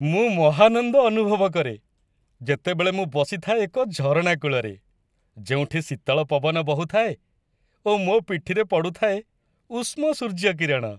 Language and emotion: Odia, happy